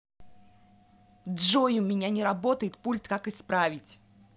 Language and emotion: Russian, angry